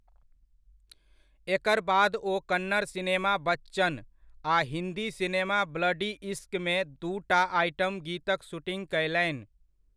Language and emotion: Maithili, neutral